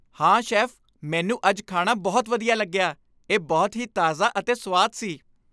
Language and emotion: Punjabi, happy